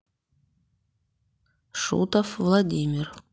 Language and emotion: Russian, neutral